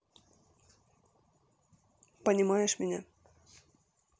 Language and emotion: Russian, neutral